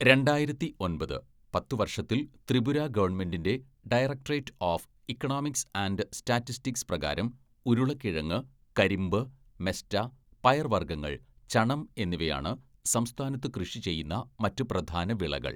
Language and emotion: Malayalam, neutral